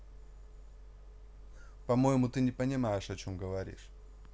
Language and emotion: Russian, neutral